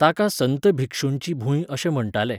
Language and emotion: Goan Konkani, neutral